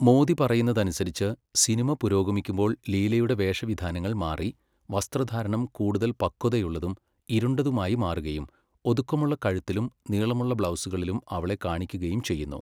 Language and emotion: Malayalam, neutral